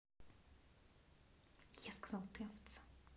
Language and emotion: Russian, angry